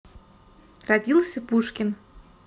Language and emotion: Russian, neutral